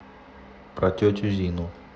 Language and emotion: Russian, neutral